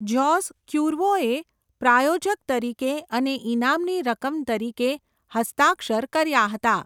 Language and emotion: Gujarati, neutral